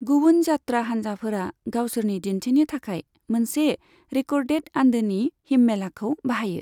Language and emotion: Bodo, neutral